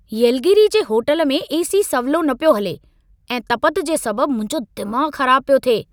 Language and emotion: Sindhi, angry